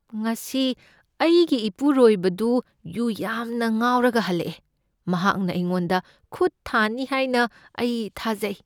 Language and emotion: Manipuri, fearful